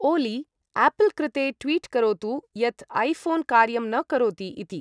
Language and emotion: Sanskrit, neutral